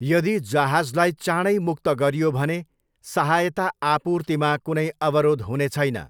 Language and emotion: Nepali, neutral